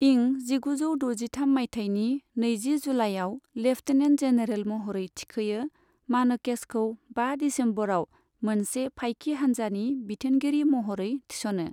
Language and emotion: Bodo, neutral